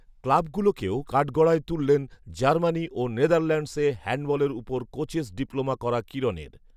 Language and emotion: Bengali, neutral